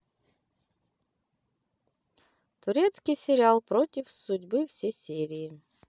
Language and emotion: Russian, positive